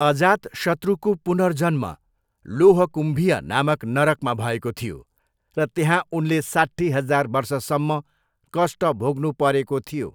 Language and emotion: Nepali, neutral